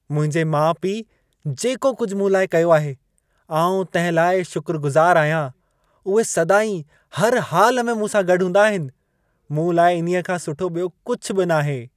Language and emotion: Sindhi, happy